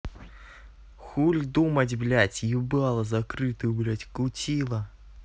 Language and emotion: Russian, angry